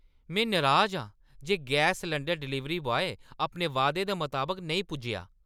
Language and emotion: Dogri, angry